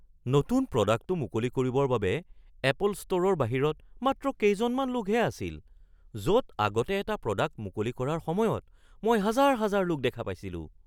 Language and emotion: Assamese, surprised